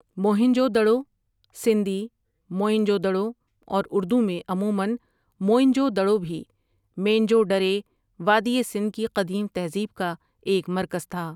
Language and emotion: Urdu, neutral